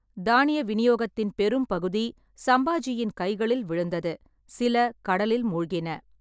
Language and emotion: Tamil, neutral